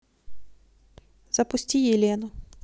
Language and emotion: Russian, neutral